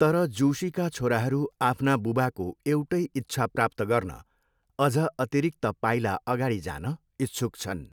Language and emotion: Nepali, neutral